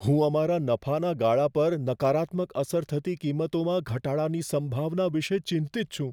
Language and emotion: Gujarati, fearful